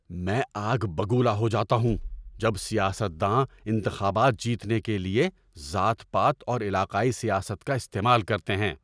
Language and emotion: Urdu, angry